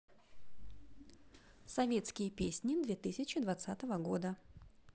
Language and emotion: Russian, neutral